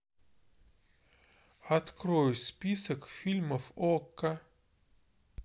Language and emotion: Russian, neutral